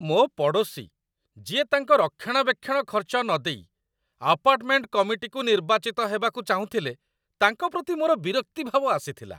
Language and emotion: Odia, disgusted